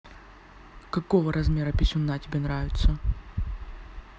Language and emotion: Russian, neutral